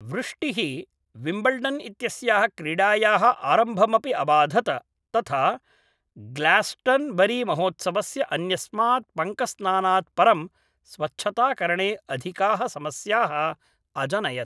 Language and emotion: Sanskrit, neutral